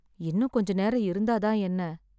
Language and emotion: Tamil, sad